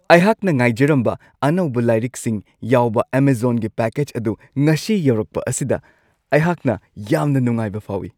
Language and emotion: Manipuri, happy